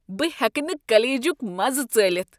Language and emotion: Kashmiri, disgusted